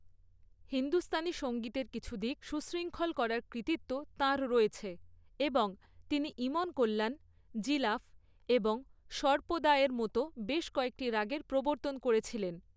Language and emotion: Bengali, neutral